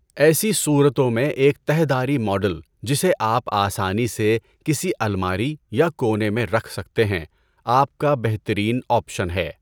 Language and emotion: Urdu, neutral